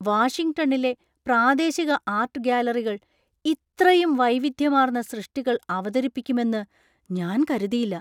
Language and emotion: Malayalam, surprised